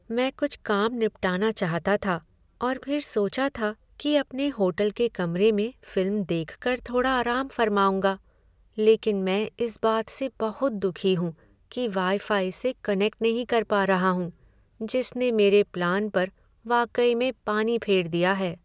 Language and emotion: Hindi, sad